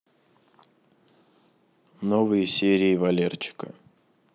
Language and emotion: Russian, neutral